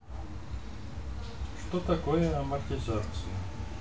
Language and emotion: Russian, neutral